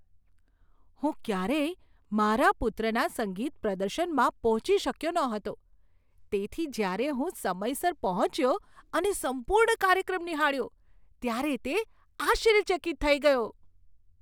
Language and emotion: Gujarati, surprised